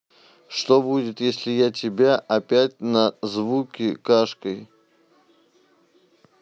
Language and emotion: Russian, neutral